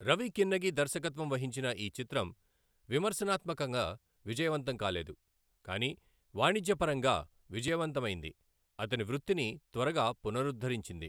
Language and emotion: Telugu, neutral